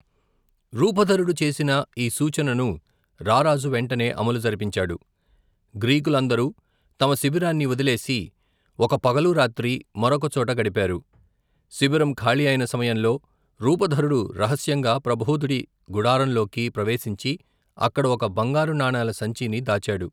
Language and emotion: Telugu, neutral